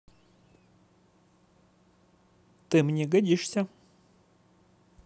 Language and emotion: Russian, positive